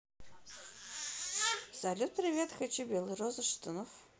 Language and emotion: Russian, neutral